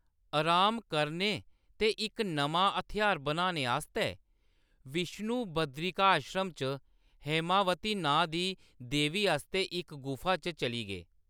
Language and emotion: Dogri, neutral